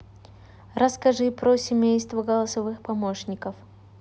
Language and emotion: Russian, neutral